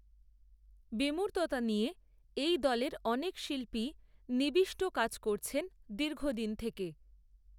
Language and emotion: Bengali, neutral